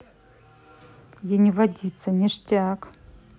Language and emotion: Russian, neutral